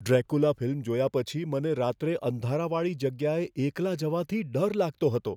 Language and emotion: Gujarati, fearful